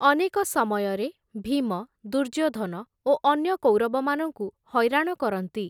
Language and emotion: Odia, neutral